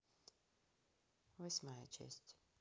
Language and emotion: Russian, neutral